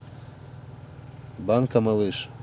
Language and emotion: Russian, neutral